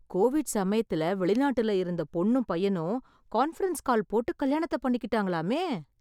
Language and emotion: Tamil, surprised